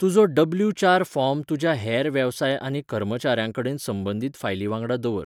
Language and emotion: Goan Konkani, neutral